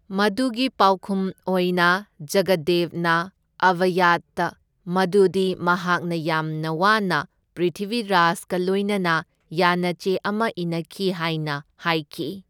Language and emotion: Manipuri, neutral